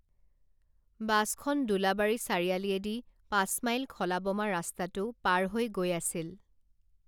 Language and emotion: Assamese, neutral